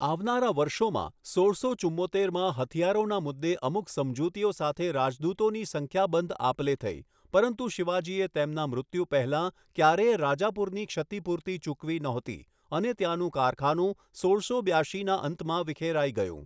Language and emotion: Gujarati, neutral